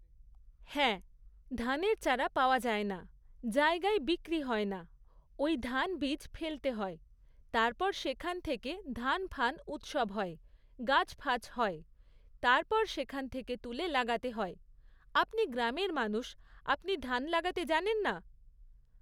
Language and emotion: Bengali, neutral